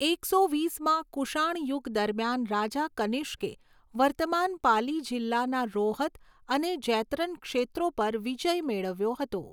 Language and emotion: Gujarati, neutral